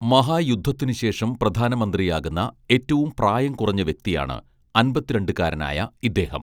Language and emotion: Malayalam, neutral